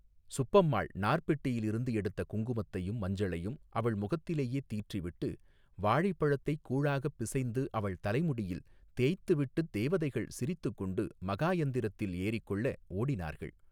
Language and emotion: Tamil, neutral